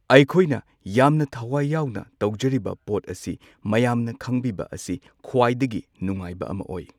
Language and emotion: Manipuri, neutral